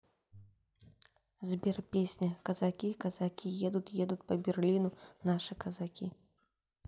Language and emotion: Russian, neutral